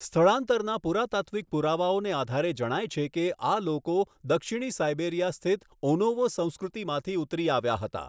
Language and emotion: Gujarati, neutral